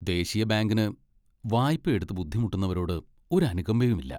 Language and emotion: Malayalam, disgusted